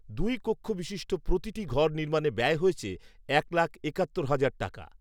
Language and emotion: Bengali, neutral